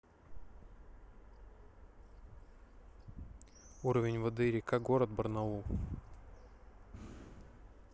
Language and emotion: Russian, neutral